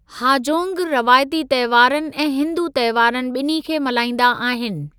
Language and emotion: Sindhi, neutral